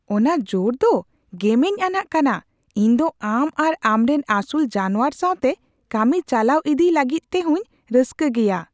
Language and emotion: Santali, surprised